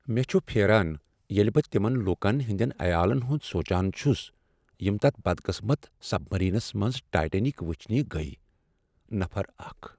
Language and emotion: Kashmiri, sad